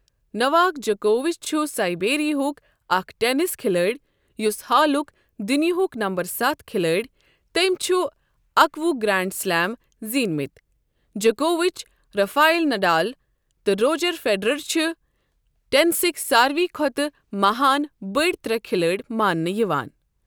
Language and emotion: Kashmiri, neutral